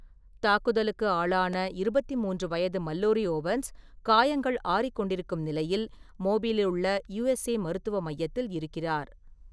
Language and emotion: Tamil, neutral